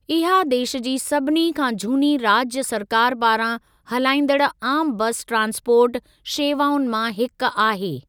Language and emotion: Sindhi, neutral